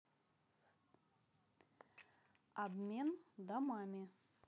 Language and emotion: Russian, neutral